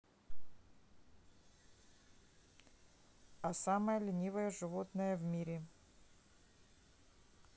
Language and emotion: Russian, neutral